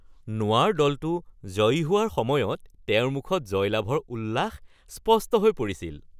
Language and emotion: Assamese, happy